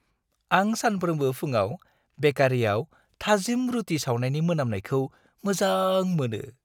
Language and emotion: Bodo, happy